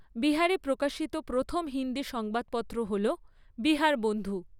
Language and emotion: Bengali, neutral